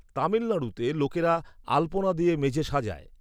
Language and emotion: Bengali, neutral